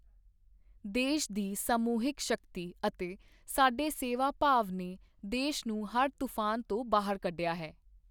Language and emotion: Punjabi, neutral